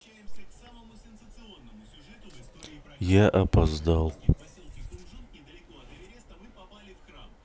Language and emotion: Russian, sad